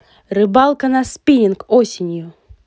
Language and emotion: Russian, positive